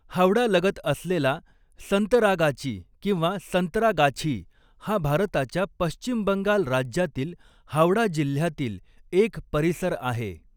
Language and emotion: Marathi, neutral